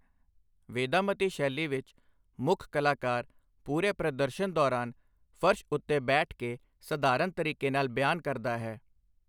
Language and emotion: Punjabi, neutral